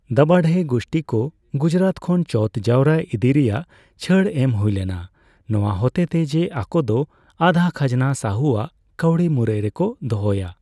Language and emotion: Santali, neutral